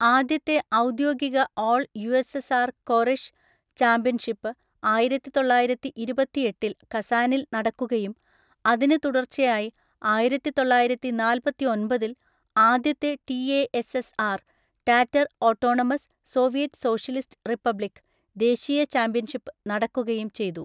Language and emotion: Malayalam, neutral